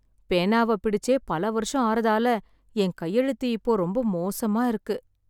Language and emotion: Tamil, sad